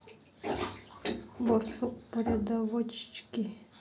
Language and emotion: Russian, sad